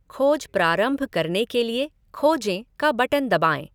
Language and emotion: Hindi, neutral